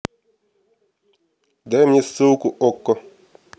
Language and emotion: Russian, neutral